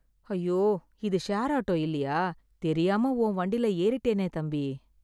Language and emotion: Tamil, sad